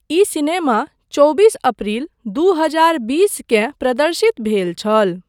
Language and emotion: Maithili, neutral